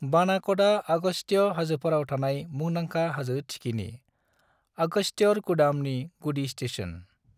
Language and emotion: Bodo, neutral